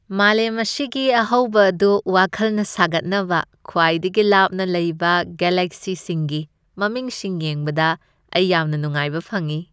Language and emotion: Manipuri, happy